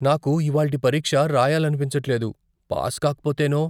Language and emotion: Telugu, fearful